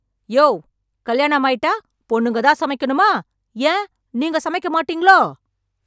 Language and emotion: Tamil, angry